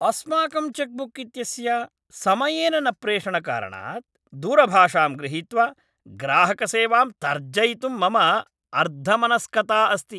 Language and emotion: Sanskrit, angry